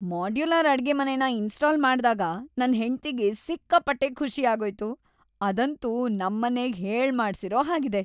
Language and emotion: Kannada, happy